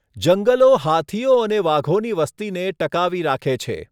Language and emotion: Gujarati, neutral